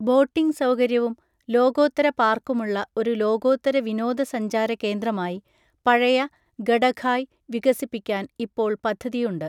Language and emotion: Malayalam, neutral